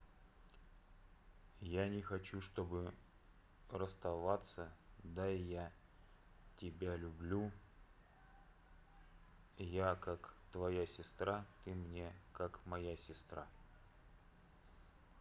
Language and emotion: Russian, sad